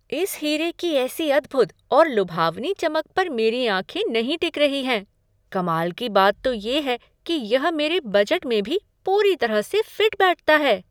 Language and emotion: Hindi, surprised